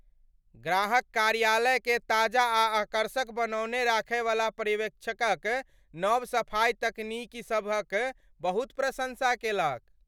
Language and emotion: Maithili, happy